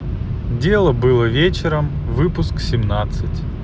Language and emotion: Russian, neutral